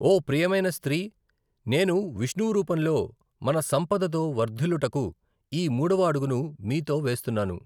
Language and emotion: Telugu, neutral